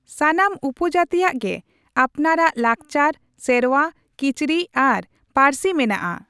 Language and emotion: Santali, neutral